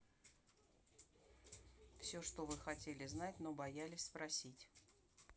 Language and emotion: Russian, neutral